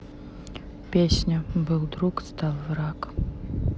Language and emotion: Russian, sad